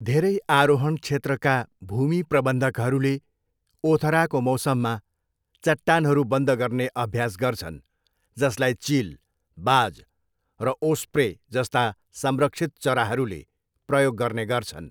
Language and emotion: Nepali, neutral